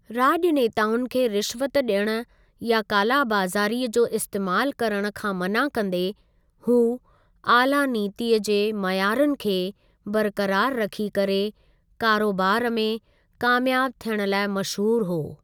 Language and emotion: Sindhi, neutral